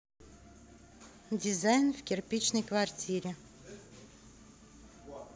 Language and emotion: Russian, neutral